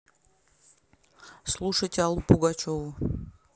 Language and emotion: Russian, neutral